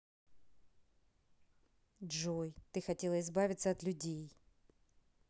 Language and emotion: Russian, neutral